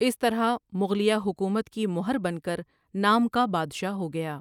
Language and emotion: Urdu, neutral